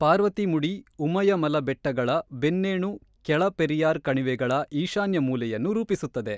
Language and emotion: Kannada, neutral